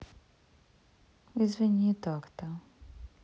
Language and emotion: Russian, sad